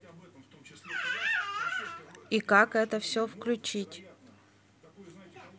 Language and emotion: Russian, neutral